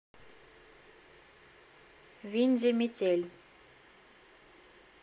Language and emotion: Russian, neutral